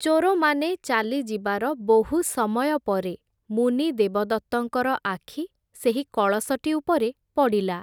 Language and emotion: Odia, neutral